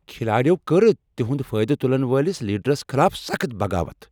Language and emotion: Kashmiri, angry